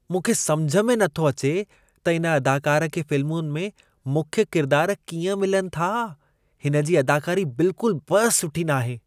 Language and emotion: Sindhi, disgusted